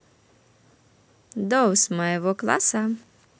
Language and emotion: Russian, positive